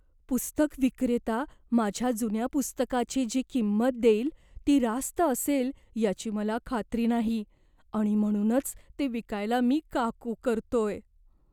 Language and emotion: Marathi, fearful